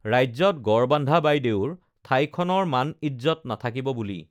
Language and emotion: Assamese, neutral